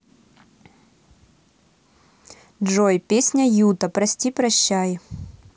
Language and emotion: Russian, neutral